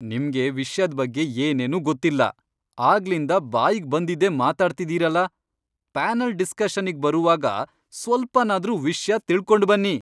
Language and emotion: Kannada, angry